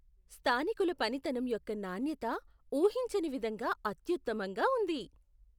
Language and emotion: Telugu, surprised